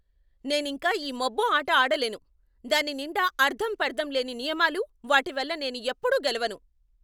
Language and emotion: Telugu, angry